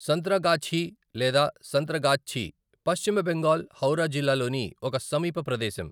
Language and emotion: Telugu, neutral